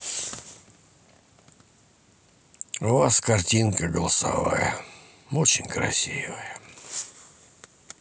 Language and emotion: Russian, sad